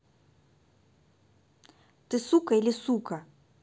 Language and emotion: Russian, angry